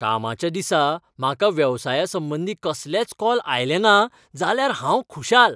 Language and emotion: Goan Konkani, happy